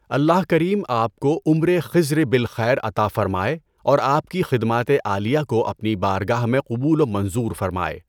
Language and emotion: Urdu, neutral